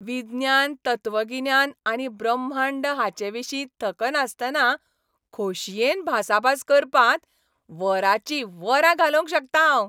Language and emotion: Goan Konkani, happy